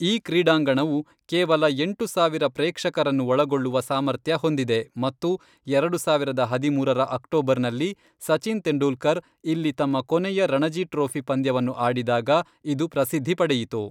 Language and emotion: Kannada, neutral